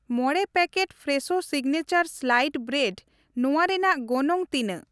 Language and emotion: Santali, neutral